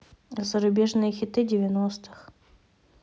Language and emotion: Russian, neutral